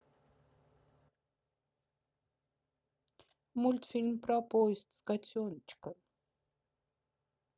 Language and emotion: Russian, sad